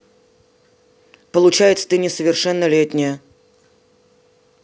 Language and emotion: Russian, neutral